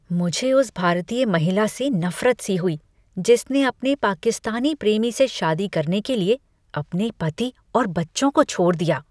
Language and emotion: Hindi, disgusted